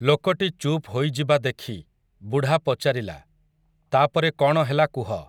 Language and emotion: Odia, neutral